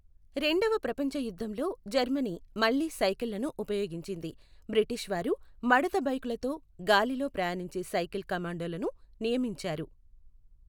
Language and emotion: Telugu, neutral